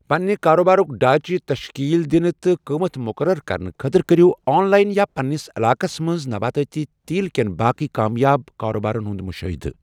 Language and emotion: Kashmiri, neutral